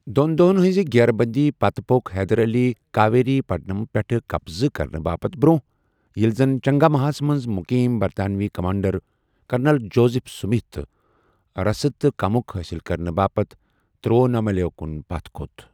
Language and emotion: Kashmiri, neutral